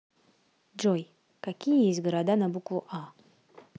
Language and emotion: Russian, neutral